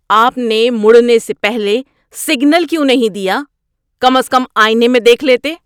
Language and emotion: Urdu, angry